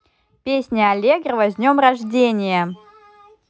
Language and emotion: Russian, positive